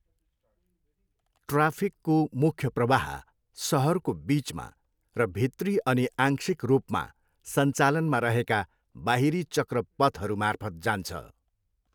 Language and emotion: Nepali, neutral